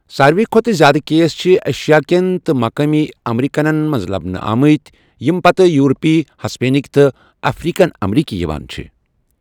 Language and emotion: Kashmiri, neutral